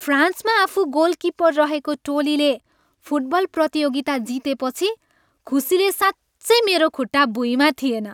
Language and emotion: Nepali, happy